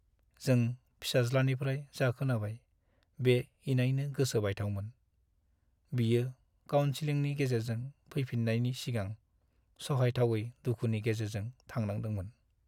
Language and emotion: Bodo, sad